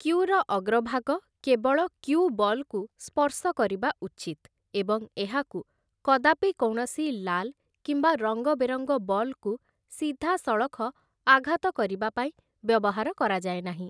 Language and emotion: Odia, neutral